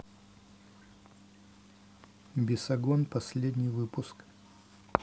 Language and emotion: Russian, neutral